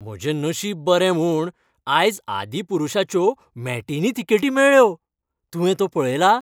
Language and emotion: Goan Konkani, happy